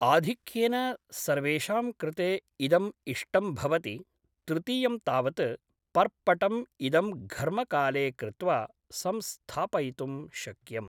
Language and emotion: Sanskrit, neutral